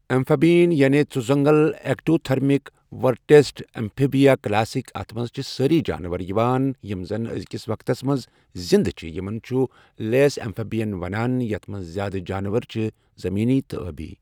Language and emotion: Kashmiri, neutral